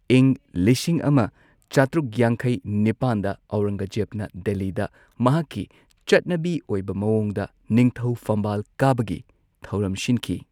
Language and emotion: Manipuri, neutral